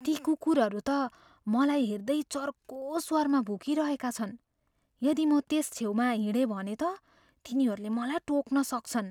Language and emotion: Nepali, fearful